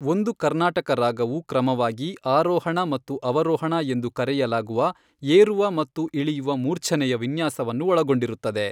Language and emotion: Kannada, neutral